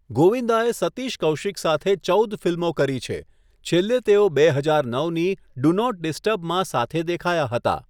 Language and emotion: Gujarati, neutral